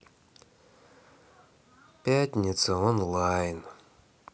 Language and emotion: Russian, sad